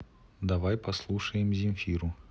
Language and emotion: Russian, neutral